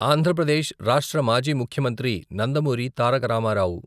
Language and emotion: Telugu, neutral